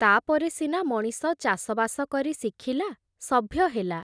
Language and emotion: Odia, neutral